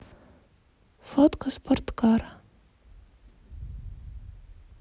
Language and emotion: Russian, neutral